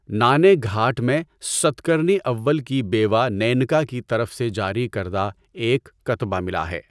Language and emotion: Urdu, neutral